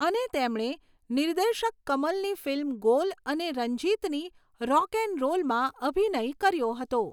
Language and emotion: Gujarati, neutral